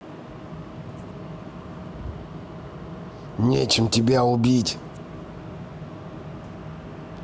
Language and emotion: Russian, angry